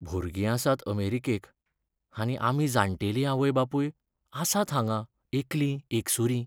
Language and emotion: Goan Konkani, sad